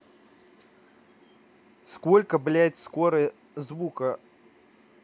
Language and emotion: Russian, angry